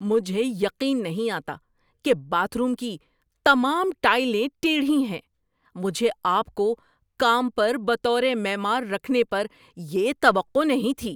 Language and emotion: Urdu, angry